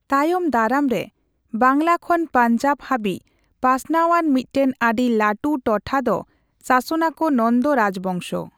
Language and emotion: Santali, neutral